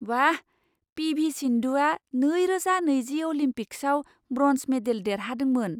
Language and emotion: Bodo, surprised